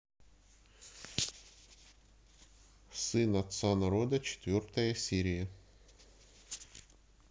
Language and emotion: Russian, neutral